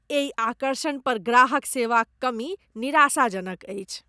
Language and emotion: Maithili, disgusted